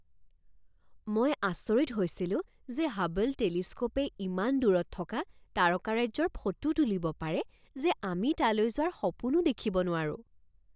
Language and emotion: Assamese, surprised